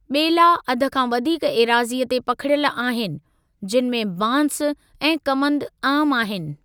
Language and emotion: Sindhi, neutral